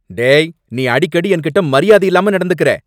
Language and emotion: Tamil, angry